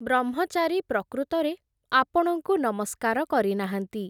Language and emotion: Odia, neutral